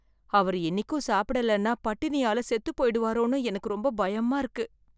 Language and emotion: Tamil, fearful